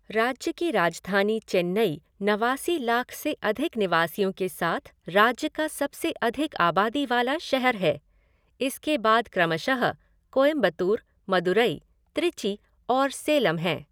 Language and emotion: Hindi, neutral